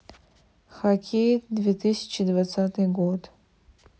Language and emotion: Russian, neutral